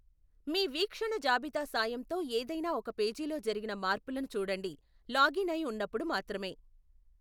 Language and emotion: Telugu, neutral